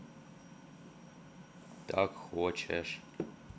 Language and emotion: Russian, neutral